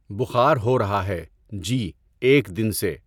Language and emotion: Urdu, neutral